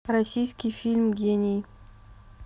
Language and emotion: Russian, neutral